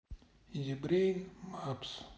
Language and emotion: Russian, sad